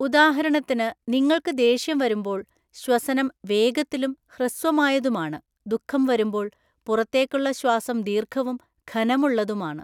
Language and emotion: Malayalam, neutral